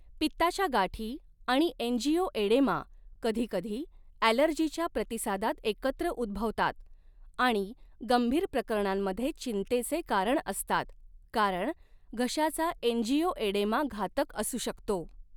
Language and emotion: Marathi, neutral